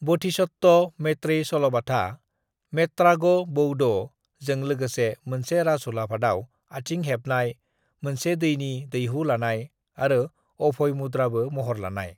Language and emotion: Bodo, neutral